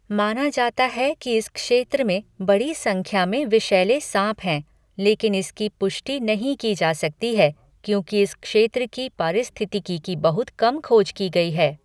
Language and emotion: Hindi, neutral